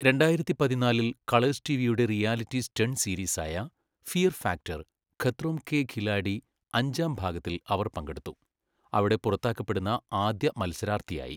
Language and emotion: Malayalam, neutral